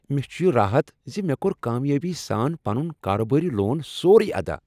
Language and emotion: Kashmiri, happy